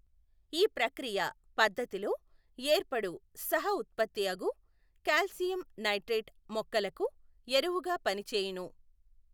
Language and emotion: Telugu, neutral